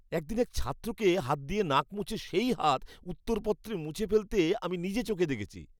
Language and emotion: Bengali, disgusted